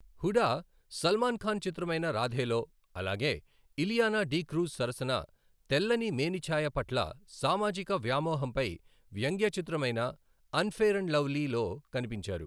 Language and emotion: Telugu, neutral